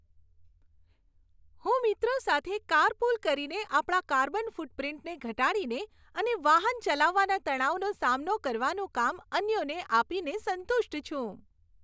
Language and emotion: Gujarati, happy